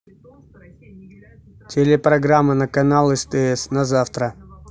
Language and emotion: Russian, neutral